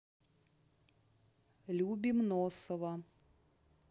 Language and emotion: Russian, neutral